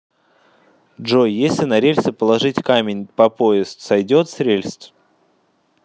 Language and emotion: Russian, neutral